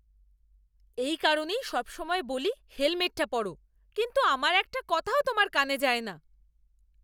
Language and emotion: Bengali, angry